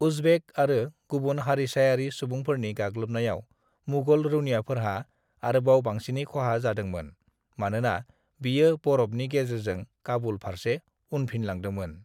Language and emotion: Bodo, neutral